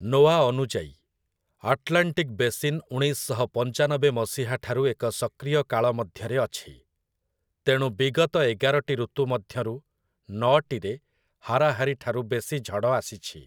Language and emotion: Odia, neutral